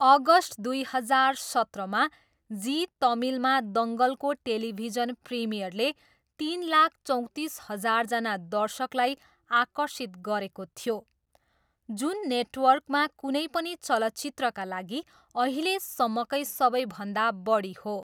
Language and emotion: Nepali, neutral